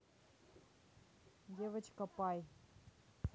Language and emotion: Russian, neutral